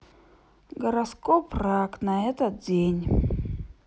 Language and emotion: Russian, neutral